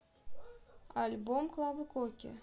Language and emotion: Russian, neutral